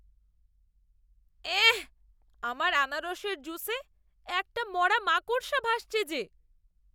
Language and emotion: Bengali, disgusted